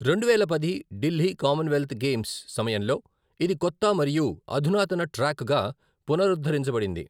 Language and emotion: Telugu, neutral